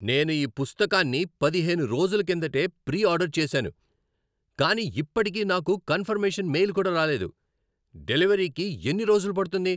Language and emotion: Telugu, angry